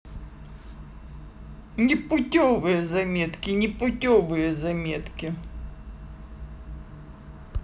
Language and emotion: Russian, angry